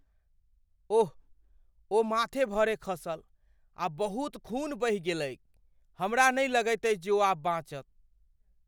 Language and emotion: Maithili, fearful